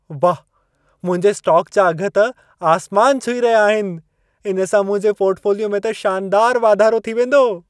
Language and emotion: Sindhi, happy